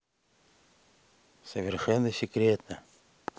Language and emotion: Russian, neutral